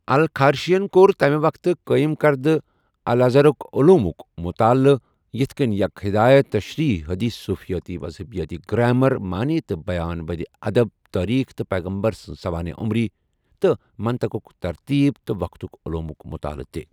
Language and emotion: Kashmiri, neutral